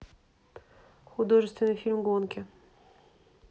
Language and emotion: Russian, neutral